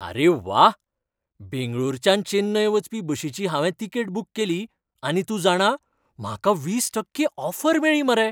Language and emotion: Goan Konkani, happy